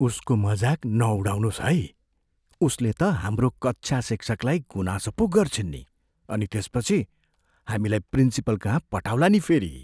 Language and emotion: Nepali, fearful